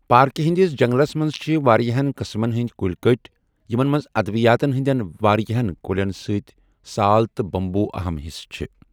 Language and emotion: Kashmiri, neutral